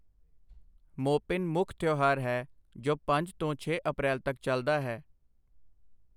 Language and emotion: Punjabi, neutral